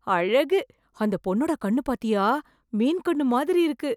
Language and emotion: Tamil, surprised